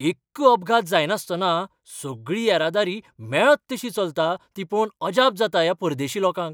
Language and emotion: Goan Konkani, surprised